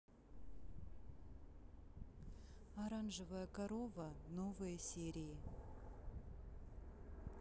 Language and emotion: Russian, neutral